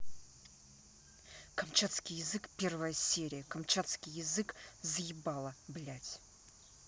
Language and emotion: Russian, angry